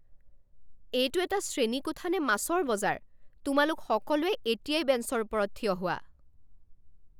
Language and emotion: Assamese, angry